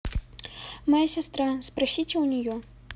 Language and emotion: Russian, neutral